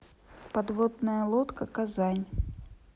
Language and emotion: Russian, neutral